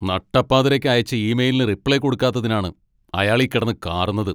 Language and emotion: Malayalam, angry